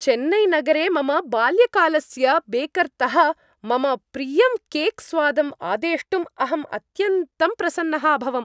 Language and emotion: Sanskrit, happy